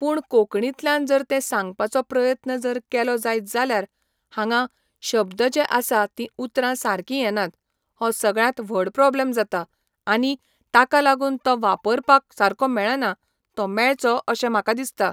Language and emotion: Goan Konkani, neutral